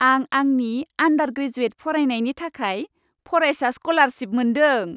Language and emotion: Bodo, happy